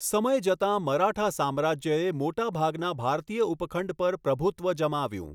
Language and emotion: Gujarati, neutral